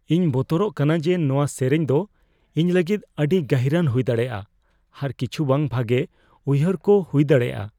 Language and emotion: Santali, fearful